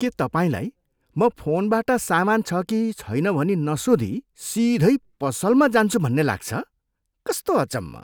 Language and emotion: Nepali, disgusted